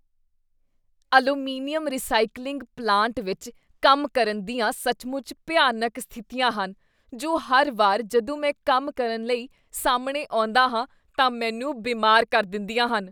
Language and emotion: Punjabi, disgusted